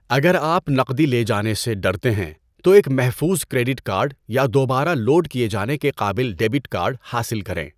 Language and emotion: Urdu, neutral